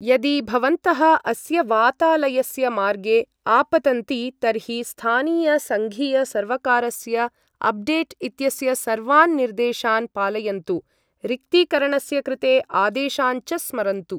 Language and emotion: Sanskrit, neutral